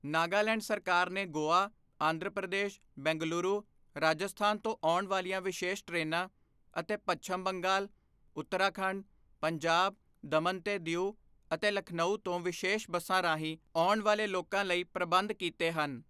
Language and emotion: Punjabi, neutral